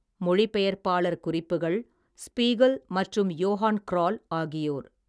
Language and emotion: Tamil, neutral